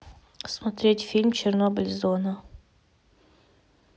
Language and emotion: Russian, neutral